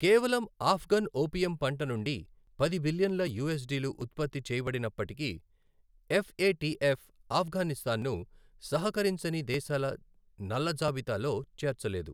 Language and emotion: Telugu, neutral